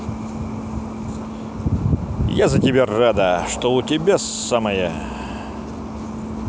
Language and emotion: Russian, positive